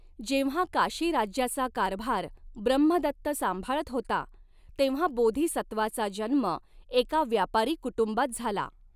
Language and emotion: Marathi, neutral